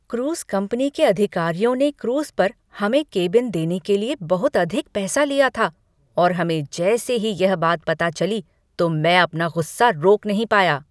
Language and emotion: Hindi, angry